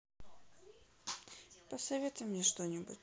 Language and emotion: Russian, sad